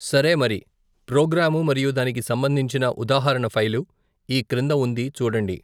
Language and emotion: Telugu, neutral